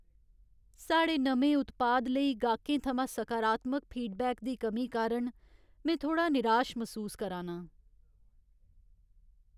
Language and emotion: Dogri, sad